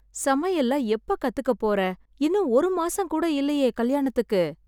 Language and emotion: Tamil, sad